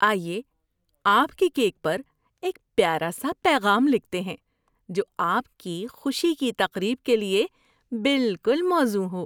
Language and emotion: Urdu, happy